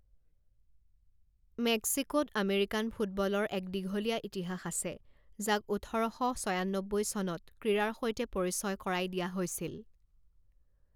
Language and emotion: Assamese, neutral